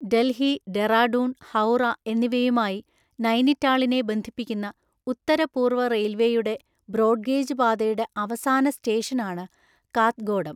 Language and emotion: Malayalam, neutral